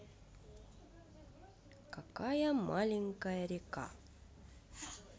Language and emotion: Russian, neutral